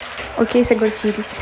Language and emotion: Russian, neutral